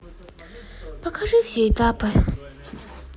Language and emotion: Russian, sad